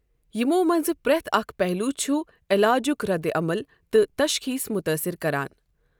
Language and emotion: Kashmiri, neutral